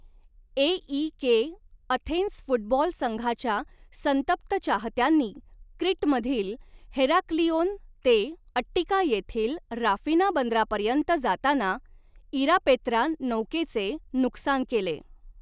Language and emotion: Marathi, neutral